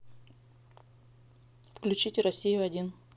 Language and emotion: Russian, neutral